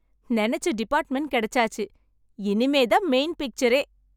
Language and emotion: Tamil, happy